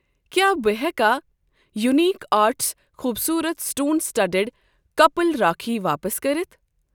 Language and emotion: Kashmiri, neutral